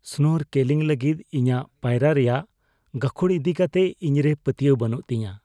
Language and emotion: Santali, fearful